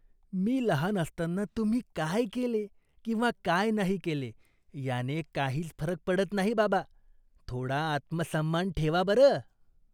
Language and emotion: Marathi, disgusted